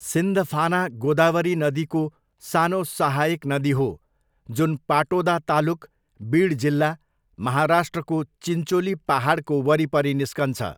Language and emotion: Nepali, neutral